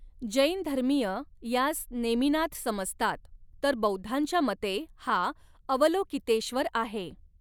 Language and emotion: Marathi, neutral